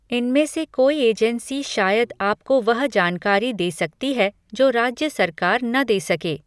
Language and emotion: Hindi, neutral